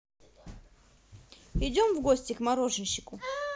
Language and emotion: Russian, positive